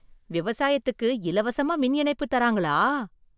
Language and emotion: Tamil, surprised